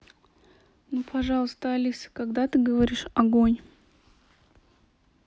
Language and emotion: Russian, neutral